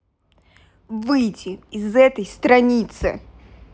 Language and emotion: Russian, angry